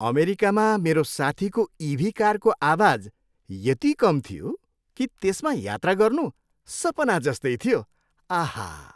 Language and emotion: Nepali, happy